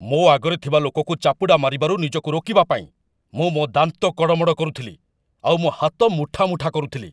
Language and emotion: Odia, angry